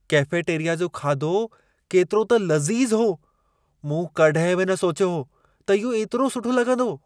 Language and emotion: Sindhi, surprised